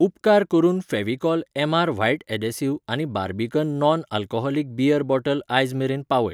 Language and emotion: Goan Konkani, neutral